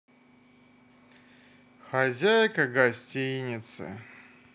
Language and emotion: Russian, sad